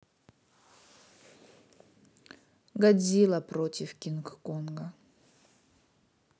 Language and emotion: Russian, neutral